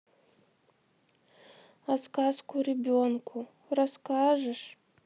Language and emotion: Russian, sad